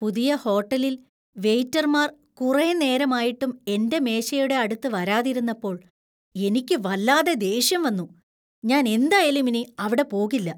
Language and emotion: Malayalam, disgusted